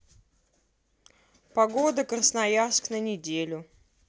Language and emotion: Russian, neutral